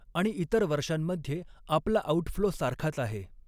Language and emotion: Marathi, neutral